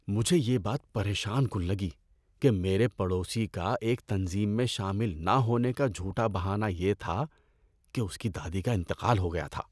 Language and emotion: Urdu, disgusted